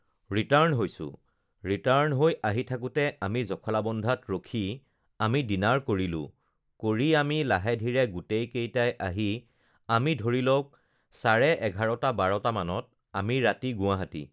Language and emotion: Assamese, neutral